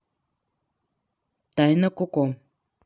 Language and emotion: Russian, neutral